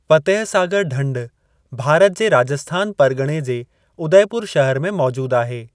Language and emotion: Sindhi, neutral